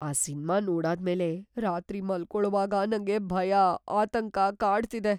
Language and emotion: Kannada, fearful